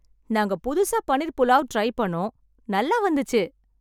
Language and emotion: Tamil, happy